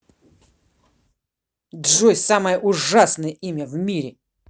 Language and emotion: Russian, angry